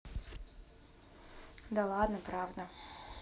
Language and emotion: Russian, neutral